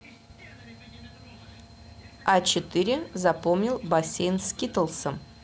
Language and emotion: Russian, neutral